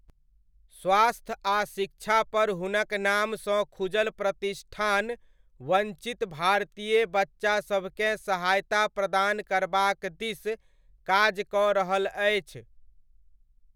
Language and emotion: Maithili, neutral